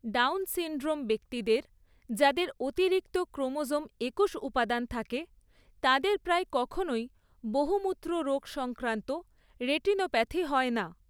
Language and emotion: Bengali, neutral